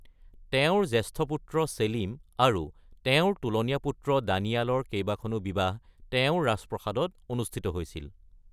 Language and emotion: Assamese, neutral